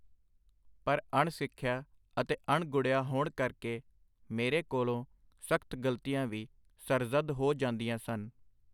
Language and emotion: Punjabi, neutral